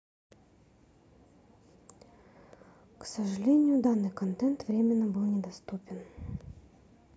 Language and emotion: Russian, sad